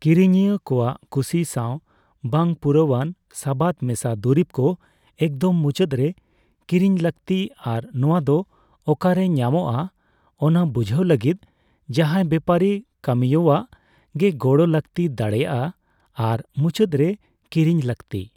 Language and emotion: Santali, neutral